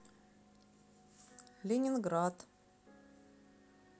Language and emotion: Russian, neutral